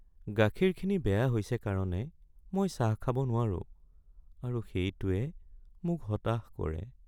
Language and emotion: Assamese, sad